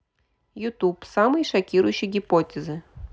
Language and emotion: Russian, neutral